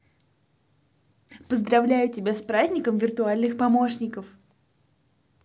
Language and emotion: Russian, positive